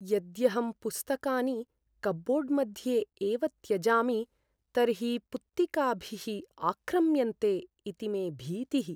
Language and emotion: Sanskrit, fearful